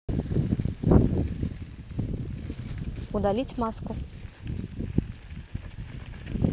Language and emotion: Russian, neutral